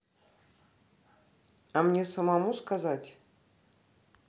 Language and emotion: Russian, neutral